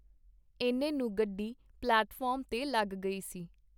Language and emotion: Punjabi, neutral